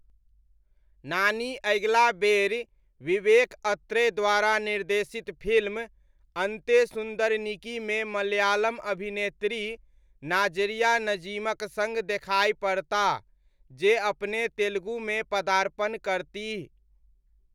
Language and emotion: Maithili, neutral